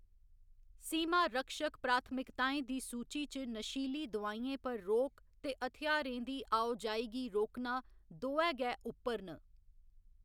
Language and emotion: Dogri, neutral